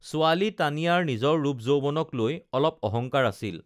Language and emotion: Assamese, neutral